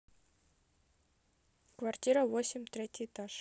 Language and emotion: Russian, neutral